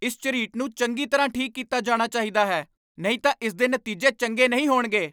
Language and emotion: Punjabi, angry